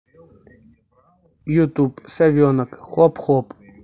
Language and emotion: Russian, neutral